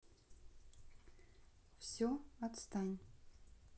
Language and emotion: Russian, neutral